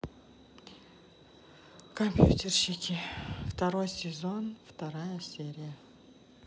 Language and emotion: Russian, sad